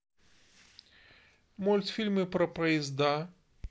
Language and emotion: Russian, neutral